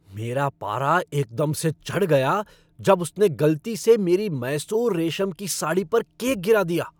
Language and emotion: Hindi, angry